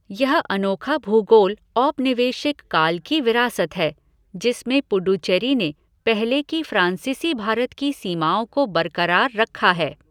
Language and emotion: Hindi, neutral